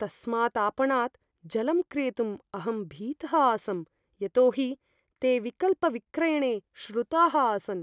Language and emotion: Sanskrit, fearful